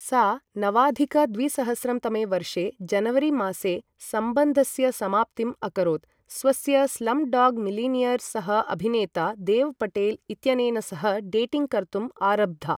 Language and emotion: Sanskrit, neutral